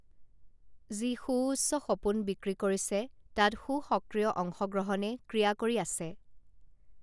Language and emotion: Assamese, neutral